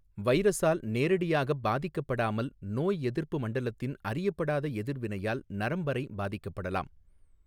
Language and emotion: Tamil, neutral